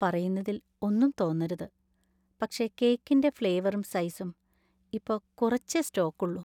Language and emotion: Malayalam, sad